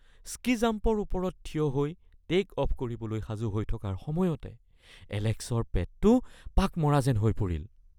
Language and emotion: Assamese, fearful